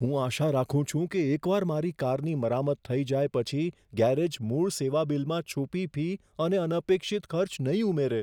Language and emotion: Gujarati, fearful